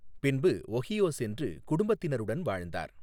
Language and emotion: Tamil, neutral